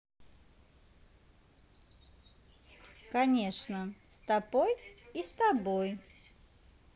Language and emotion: Russian, positive